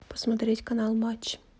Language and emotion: Russian, neutral